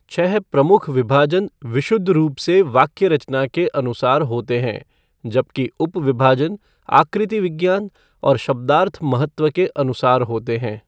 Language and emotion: Hindi, neutral